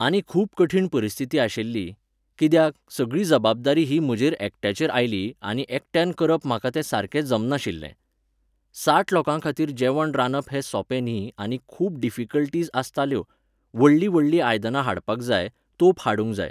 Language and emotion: Goan Konkani, neutral